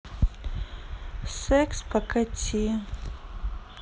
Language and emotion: Russian, neutral